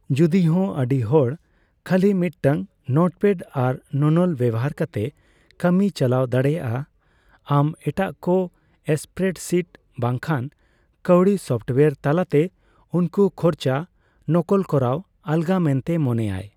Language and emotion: Santali, neutral